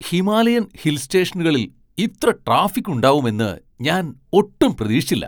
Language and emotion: Malayalam, surprised